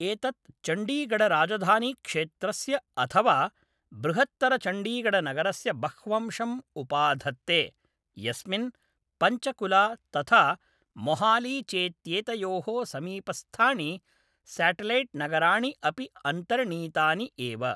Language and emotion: Sanskrit, neutral